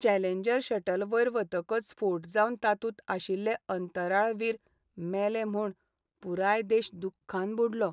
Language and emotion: Goan Konkani, sad